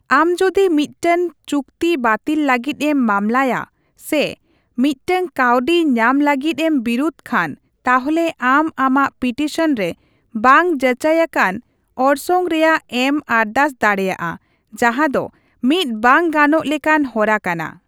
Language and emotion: Santali, neutral